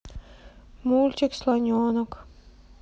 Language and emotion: Russian, sad